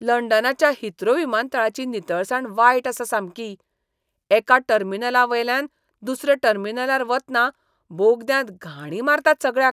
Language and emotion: Goan Konkani, disgusted